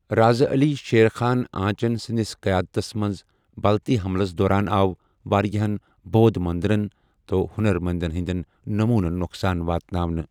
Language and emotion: Kashmiri, neutral